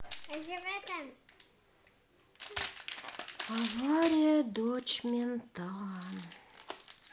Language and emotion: Russian, sad